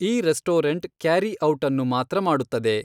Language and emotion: Kannada, neutral